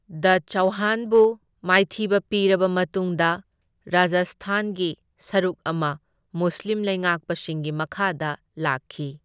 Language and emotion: Manipuri, neutral